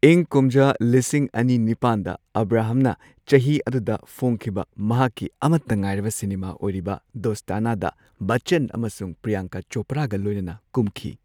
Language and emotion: Manipuri, neutral